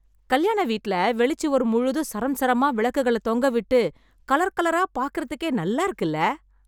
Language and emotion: Tamil, happy